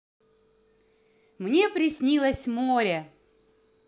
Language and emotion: Russian, positive